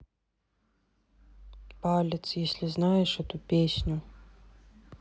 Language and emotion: Russian, sad